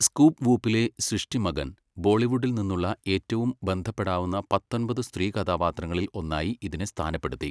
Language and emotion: Malayalam, neutral